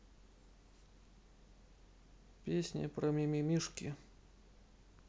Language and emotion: Russian, neutral